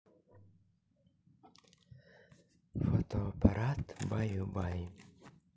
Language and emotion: Russian, neutral